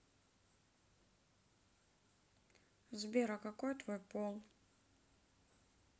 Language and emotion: Russian, neutral